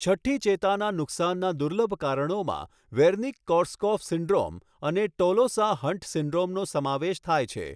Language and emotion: Gujarati, neutral